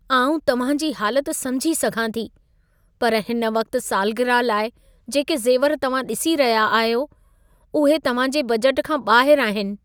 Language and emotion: Sindhi, sad